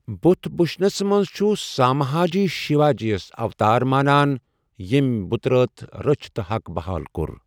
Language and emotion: Kashmiri, neutral